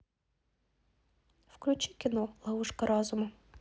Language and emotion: Russian, neutral